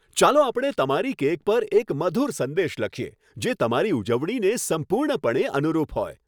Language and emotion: Gujarati, happy